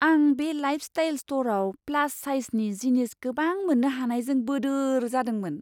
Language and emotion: Bodo, surprised